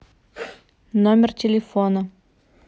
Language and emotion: Russian, neutral